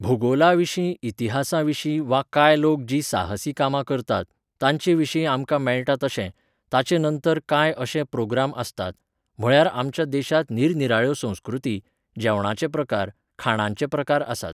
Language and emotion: Goan Konkani, neutral